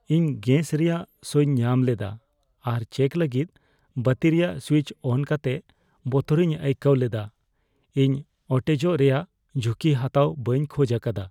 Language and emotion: Santali, fearful